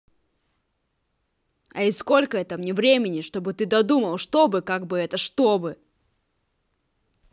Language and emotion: Russian, angry